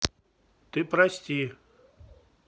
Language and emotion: Russian, neutral